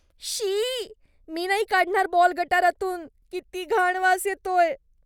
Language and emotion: Marathi, disgusted